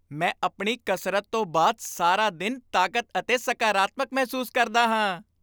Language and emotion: Punjabi, happy